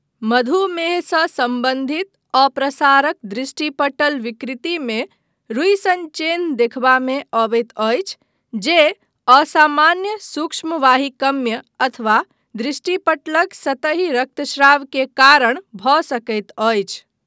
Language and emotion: Maithili, neutral